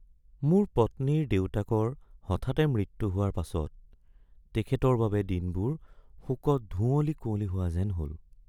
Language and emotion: Assamese, sad